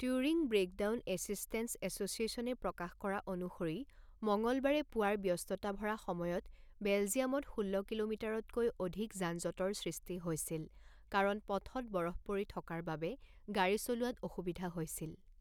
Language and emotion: Assamese, neutral